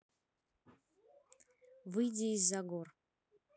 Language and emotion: Russian, neutral